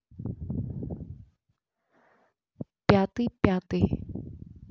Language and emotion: Russian, neutral